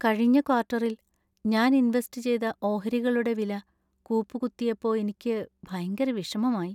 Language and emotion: Malayalam, sad